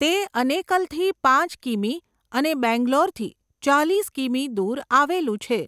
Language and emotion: Gujarati, neutral